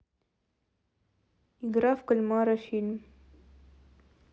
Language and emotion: Russian, neutral